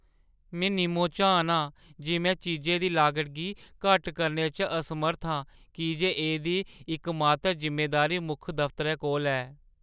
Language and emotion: Dogri, sad